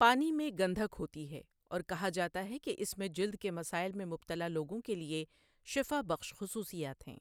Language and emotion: Urdu, neutral